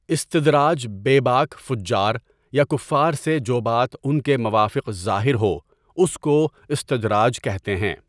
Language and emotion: Urdu, neutral